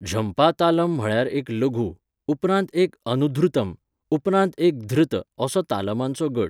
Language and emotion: Goan Konkani, neutral